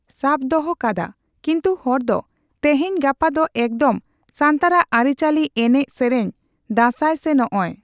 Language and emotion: Santali, neutral